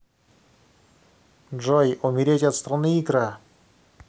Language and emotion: Russian, neutral